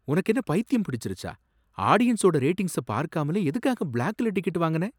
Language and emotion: Tamil, surprised